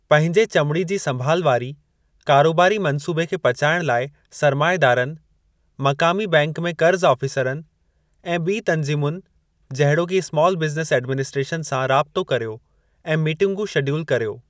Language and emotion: Sindhi, neutral